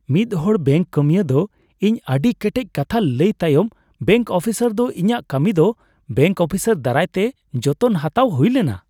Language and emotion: Santali, happy